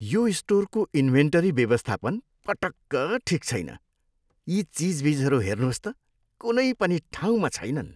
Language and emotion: Nepali, disgusted